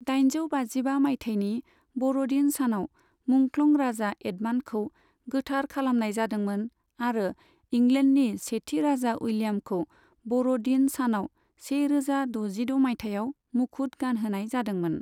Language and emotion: Bodo, neutral